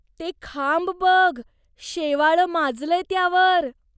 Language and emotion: Marathi, disgusted